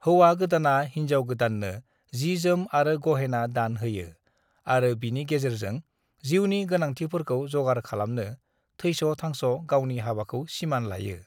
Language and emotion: Bodo, neutral